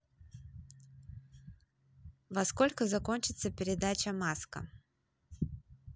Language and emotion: Russian, positive